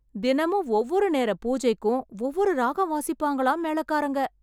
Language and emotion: Tamil, surprised